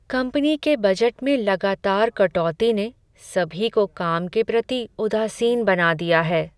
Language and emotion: Hindi, sad